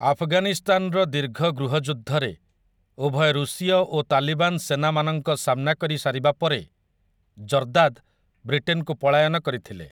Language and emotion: Odia, neutral